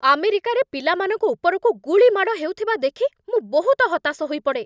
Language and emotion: Odia, angry